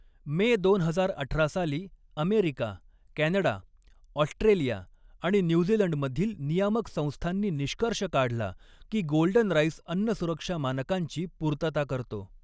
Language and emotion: Marathi, neutral